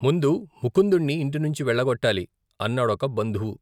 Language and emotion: Telugu, neutral